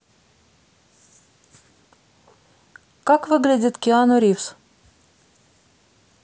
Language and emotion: Russian, neutral